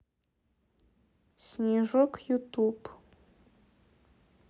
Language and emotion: Russian, neutral